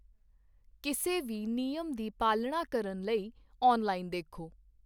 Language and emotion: Punjabi, neutral